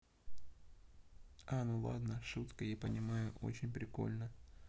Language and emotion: Russian, neutral